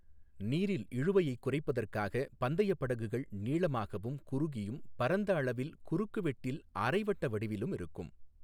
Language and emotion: Tamil, neutral